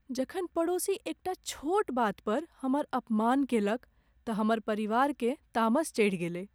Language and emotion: Maithili, sad